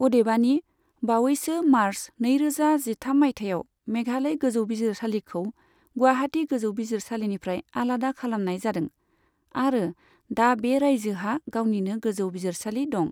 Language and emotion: Bodo, neutral